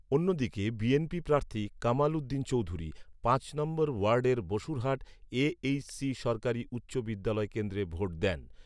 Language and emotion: Bengali, neutral